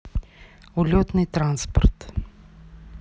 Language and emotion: Russian, neutral